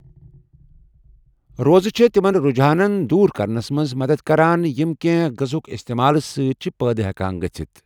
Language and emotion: Kashmiri, neutral